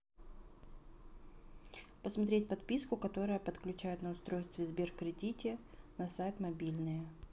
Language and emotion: Russian, neutral